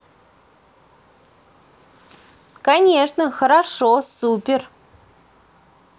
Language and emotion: Russian, positive